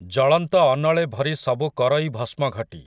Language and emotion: Odia, neutral